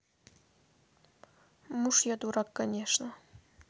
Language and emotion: Russian, neutral